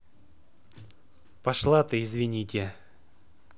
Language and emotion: Russian, neutral